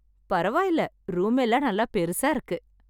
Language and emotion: Tamil, happy